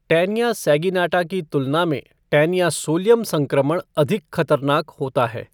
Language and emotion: Hindi, neutral